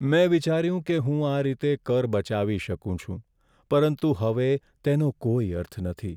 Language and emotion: Gujarati, sad